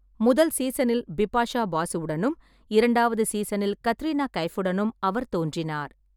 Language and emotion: Tamil, neutral